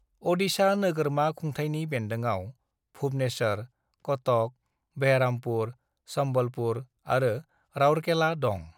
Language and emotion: Bodo, neutral